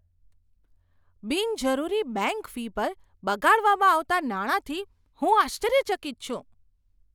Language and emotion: Gujarati, surprised